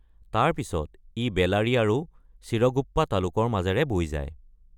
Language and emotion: Assamese, neutral